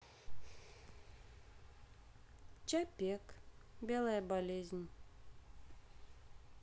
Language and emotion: Russian, sad